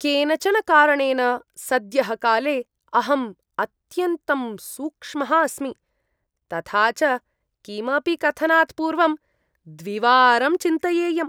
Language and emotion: Sanskrit, disgusted